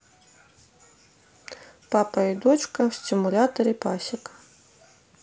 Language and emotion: Russian, neutral